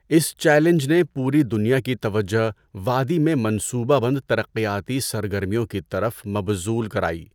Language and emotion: Urdu, neutral